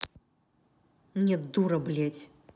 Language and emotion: Russian, angry